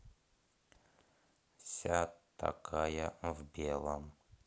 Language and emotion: Russian, neutral